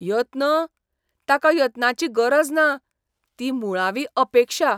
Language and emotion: Goan Konkani, disgusted